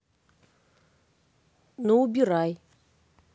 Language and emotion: Russian, neutral